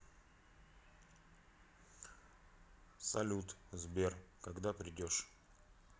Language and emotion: Russian, neutral